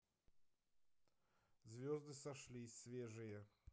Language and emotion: Russian, neutral